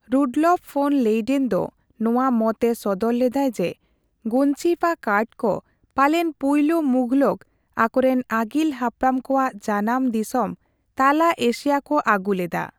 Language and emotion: Santali, neutral